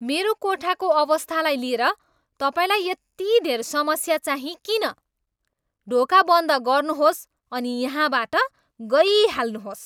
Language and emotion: Nepali, angry